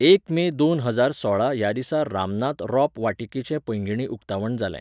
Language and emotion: Goan Konkani, neutral